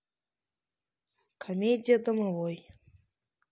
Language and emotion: Russian, neutral